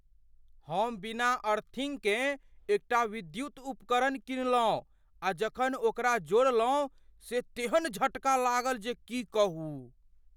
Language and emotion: Maithili, fearful